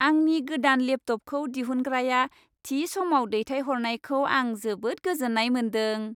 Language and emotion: Bodo, happy